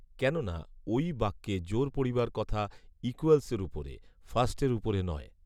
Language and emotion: Bengali, neutral